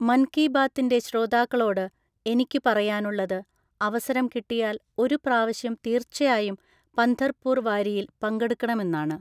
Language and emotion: Malayalam, neutral